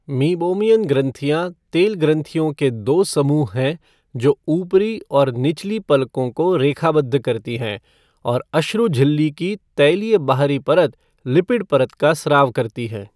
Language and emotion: Hindi, neutral